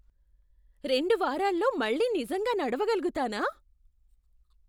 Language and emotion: Telugu, surprised